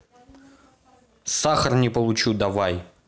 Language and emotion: Russian, angry